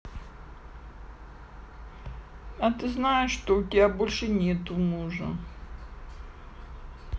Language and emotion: Russian, sad